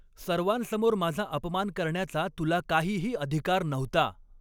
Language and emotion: Marathi, angry